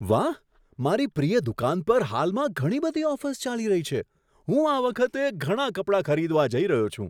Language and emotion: Gujarati, surprised